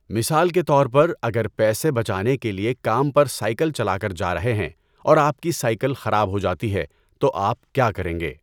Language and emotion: Urdu, neutral